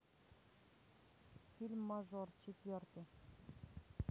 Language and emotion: Russian, neutral